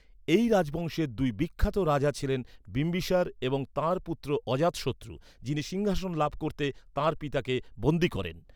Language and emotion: Bengali, neutral